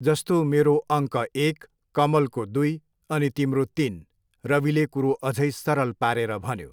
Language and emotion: Nepali, neutral